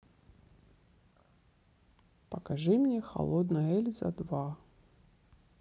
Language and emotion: Russian, neutral